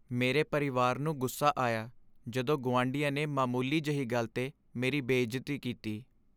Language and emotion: Punjabi, sad